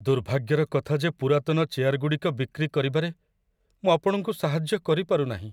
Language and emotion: Odia, sad